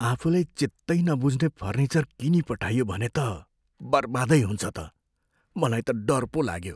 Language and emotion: Nepali, fearful